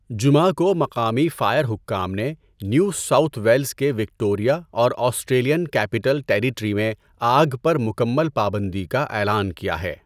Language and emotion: Urdu, neutral